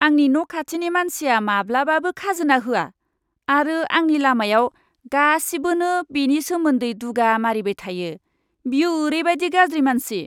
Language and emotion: Bodo, disgusted